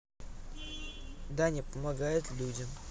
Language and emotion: Russian, neutral